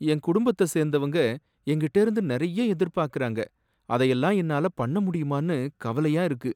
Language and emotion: Tamil, sad